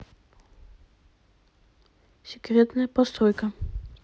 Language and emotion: Russian, neutral